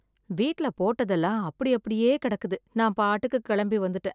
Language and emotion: Tamil, sad